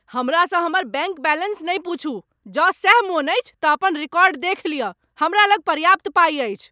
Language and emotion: Maithili, angry